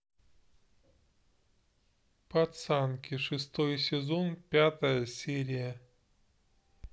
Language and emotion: Russian, neutral